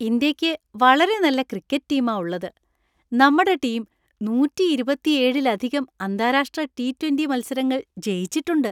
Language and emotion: Malayalam, happy